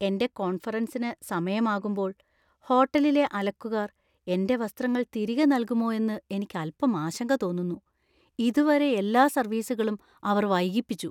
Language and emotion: Malayalam, fearful